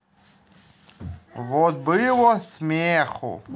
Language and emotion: Russian, positive